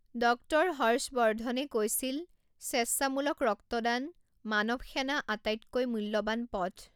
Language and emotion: Assamese, neutral